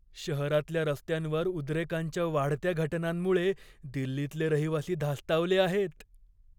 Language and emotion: Marathi, fearful